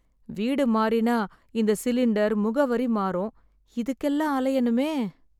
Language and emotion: Tamil, sad